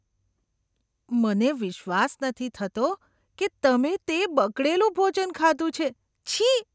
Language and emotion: Gujarati, disgusted